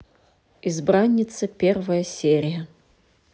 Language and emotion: Russian, neutral